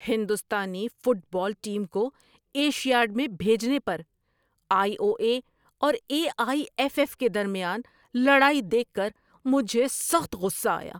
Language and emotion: Urdu, angry